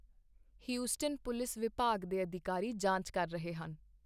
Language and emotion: Punjabi, neutral